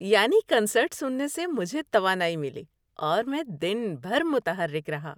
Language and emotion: Urdu, happy